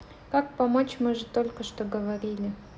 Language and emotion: Russian, neutral